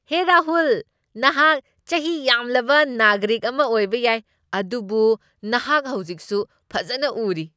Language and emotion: Manipuri, happy